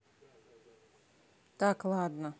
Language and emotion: Russian, neutral